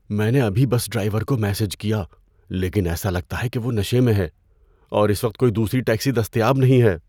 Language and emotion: Urdu, fearful